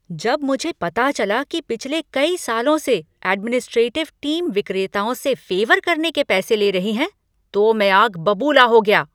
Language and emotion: Hindi, angry